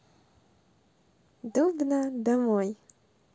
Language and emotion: Russian, positive